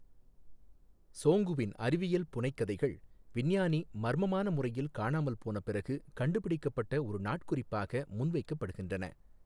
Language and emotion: Tamil, neutral